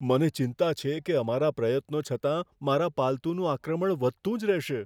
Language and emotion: Gujarati, fearful